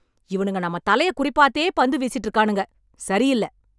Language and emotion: Tamil, angry